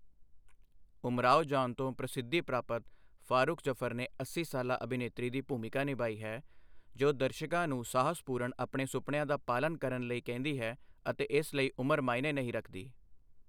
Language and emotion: Punjabi, neutral